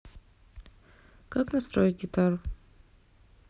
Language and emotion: Russian, neutral